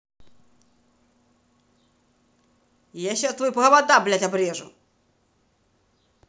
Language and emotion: Russian, angry